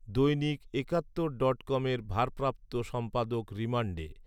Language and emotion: Bengali, neutral